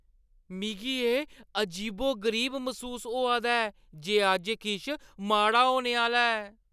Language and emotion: Dogri, fearful